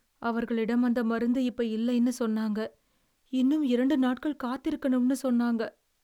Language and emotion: Tamil, sad